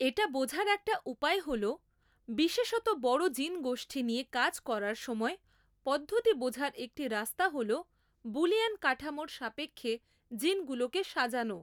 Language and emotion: Bengali, neutral